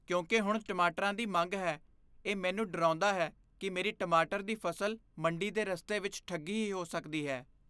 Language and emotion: Punjabi, fearful